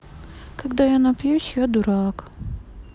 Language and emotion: Russian, sad